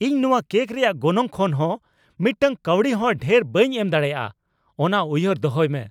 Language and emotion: Santali, angry